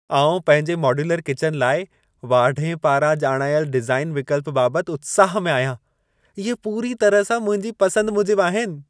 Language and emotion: Sindhi, happy